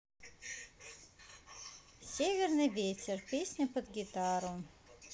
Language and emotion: Russian, neutral